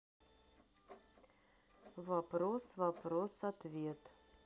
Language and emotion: Russian, neutral